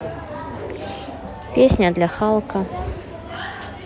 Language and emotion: Russian, neutral